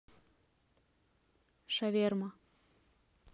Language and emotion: Russian, neutral